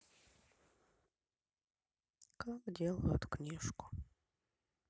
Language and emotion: Russian, sad